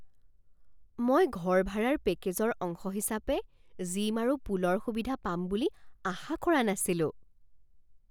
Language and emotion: Assamese, surprised